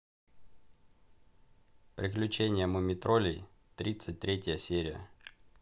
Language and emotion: Russian, neutral